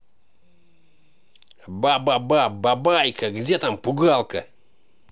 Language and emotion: Russian, angry